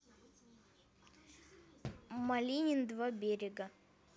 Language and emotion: Russian, neutral